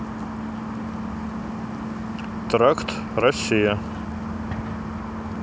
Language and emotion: Russian, neutral